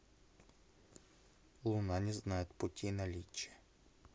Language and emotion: Russian, neutral